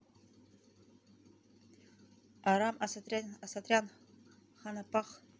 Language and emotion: Russian, neutral